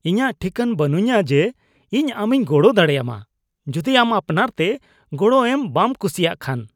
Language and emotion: Santali, disgusted